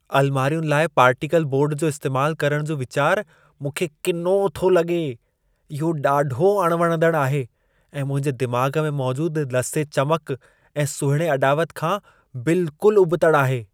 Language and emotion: Sindhi, disgusted